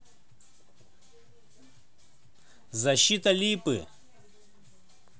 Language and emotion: Russian, neutral